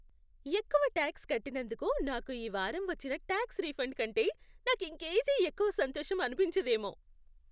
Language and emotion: Telugu, happy